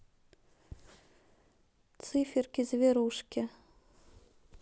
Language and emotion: Russian, neutral